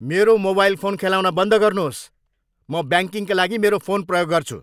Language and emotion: Nepali, angry